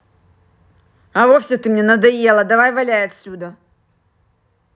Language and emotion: Russian, angry